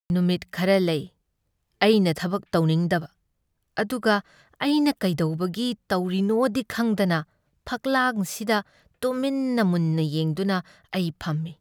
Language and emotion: Manipuri, sad